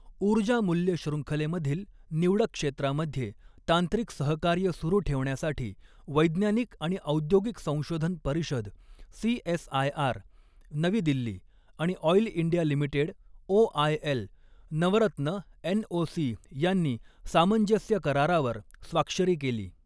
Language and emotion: Marathi, neutral